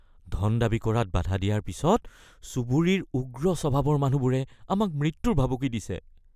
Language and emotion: Assamese, fearful